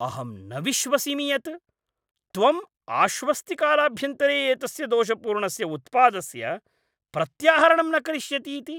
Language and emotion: Sanskrit, angry